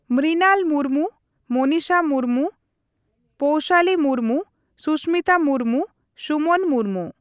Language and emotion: Santali, neutral